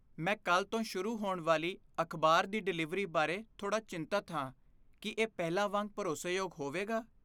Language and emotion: Punjabi, fearful